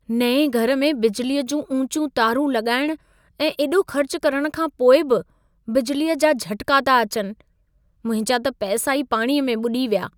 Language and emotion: Sindhi, sad